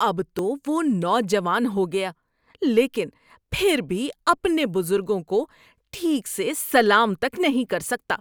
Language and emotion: Urdu, disgusted